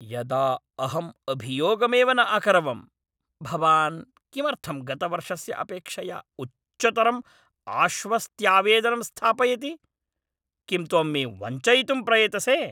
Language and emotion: Sanskrit, angry